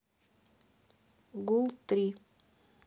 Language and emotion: Russian, neutral